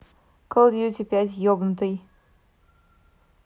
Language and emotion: Russian, neutral